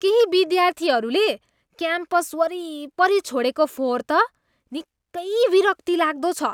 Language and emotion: Nepali, disgusted